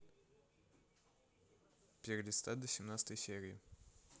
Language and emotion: Russian, neutral